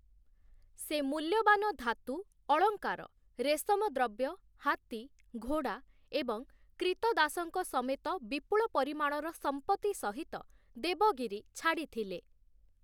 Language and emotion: Odia, neutral